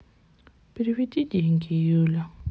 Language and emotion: Russian, sad